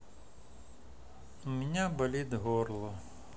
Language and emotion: Russian, sad